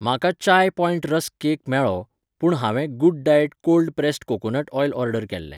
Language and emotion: Goan Konkani, neutral